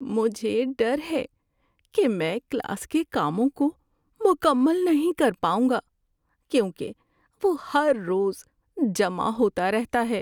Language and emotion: Urdu, fearful